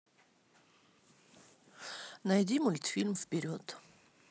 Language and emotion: Russian, neutral